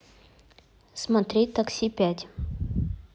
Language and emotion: Russian, neutral